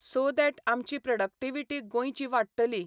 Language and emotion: Goan Konkani, neutral